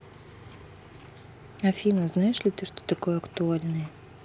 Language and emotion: Russian, neutral